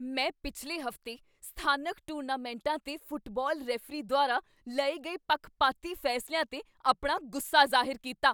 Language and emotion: Punjabi, angry